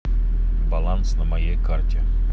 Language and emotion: Russian, neutral